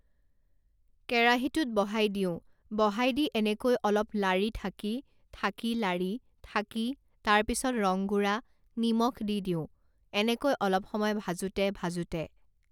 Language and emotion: Assamese, neutral